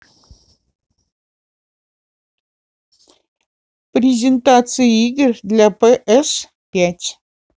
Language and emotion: Russian, neutral